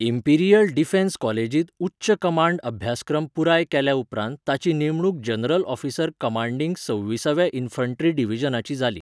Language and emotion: Goan Konkani, neutral